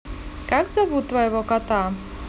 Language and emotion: Russian, positive